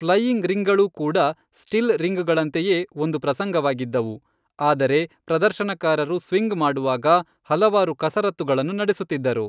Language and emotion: Kannada, neutral